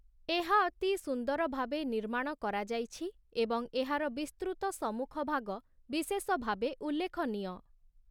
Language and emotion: Odia, neutral